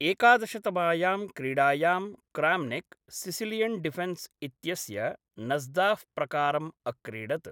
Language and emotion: Sanskrit, neutral